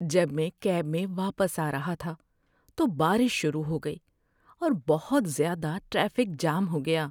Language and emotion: Urdu, sad